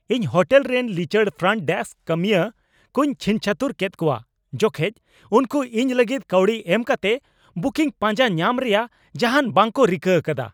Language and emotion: Santali, angry